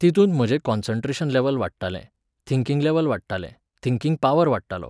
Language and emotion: Goan Konkani, neutral